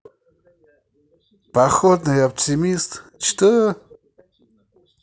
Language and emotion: Russian, positive